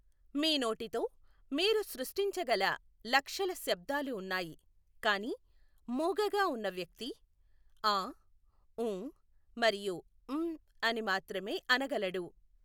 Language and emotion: Telugu, neutral